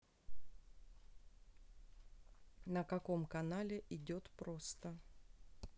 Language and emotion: Russian, neutral